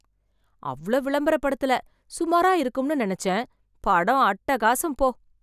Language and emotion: Tamil, surprised